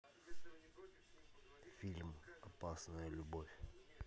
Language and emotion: Russian, neutral